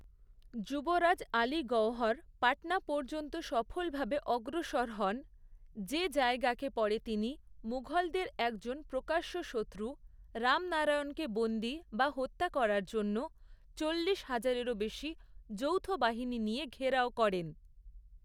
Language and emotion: Bengali, neutral